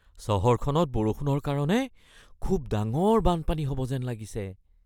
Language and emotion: Assamese, fearful